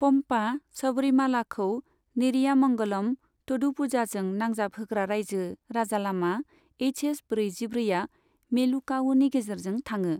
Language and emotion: Bodo, neutral